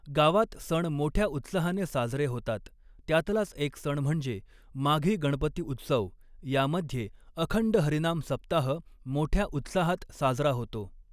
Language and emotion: Marathi, neutral